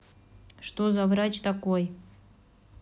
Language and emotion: Russian, neutral